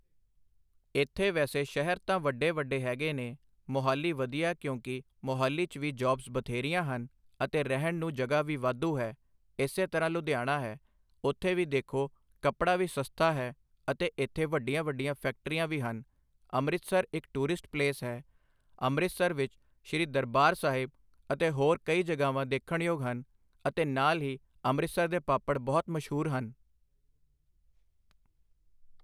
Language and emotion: Punjabi, neutral